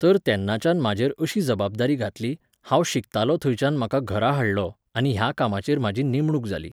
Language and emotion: Goan Konkani, neutral